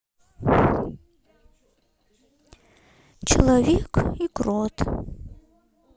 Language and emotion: Russian, sad